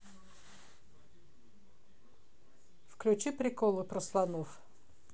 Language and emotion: Russian, neutral